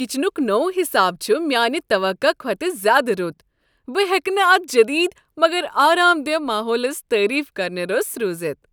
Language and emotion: Kashmiri, happy